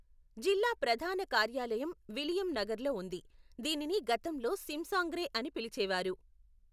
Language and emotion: Telugu, neutral